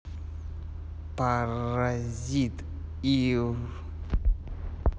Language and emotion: Russian, neutral